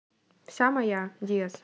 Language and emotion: Russian, neutral